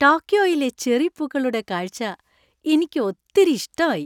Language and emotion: Malayalam, happy